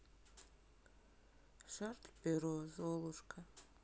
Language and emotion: Russian, sad